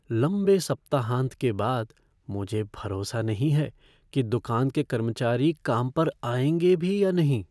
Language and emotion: Hindi, fearful